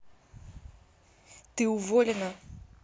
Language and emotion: Russian, angry